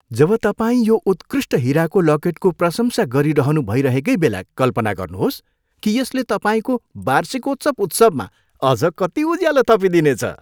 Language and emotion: Nepali, happy